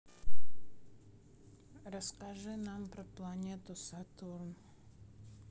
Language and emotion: Russian, neutral